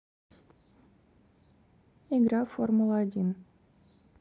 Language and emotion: Russian, neutral